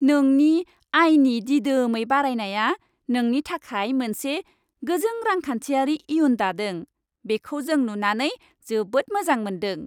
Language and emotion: Bodo, happy